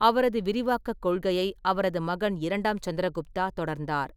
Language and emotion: Tamil, neutral